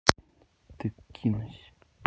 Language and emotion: Russian, neutral